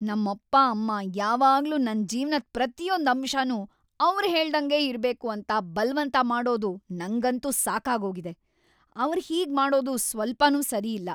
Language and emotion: Kannada, angry